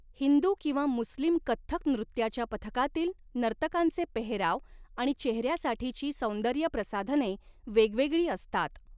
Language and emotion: Marathi, neutral